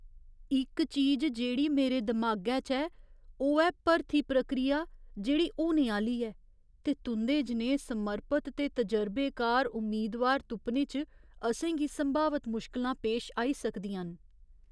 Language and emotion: Dogri, fearful